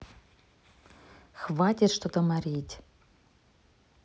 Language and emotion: Russian, neutral